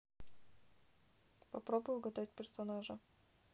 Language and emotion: Russian, neutral